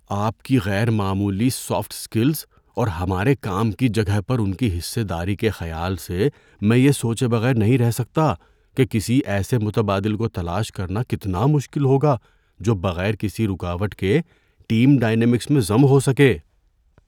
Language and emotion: Urdu, fearful